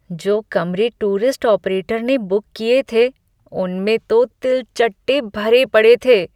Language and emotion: Hindi, disgusted